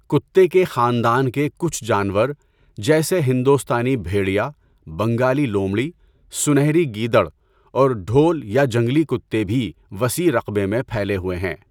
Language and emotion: Urdu, neutral